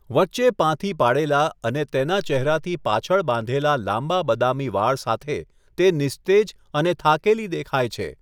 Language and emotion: Gujarati, neutral